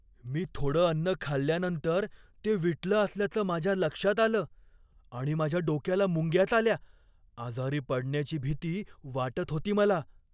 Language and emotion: Marathi, fearful